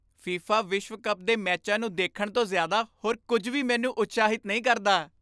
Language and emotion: Punjabi, happy